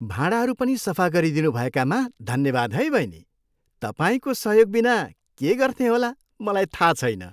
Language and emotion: Nepali, happy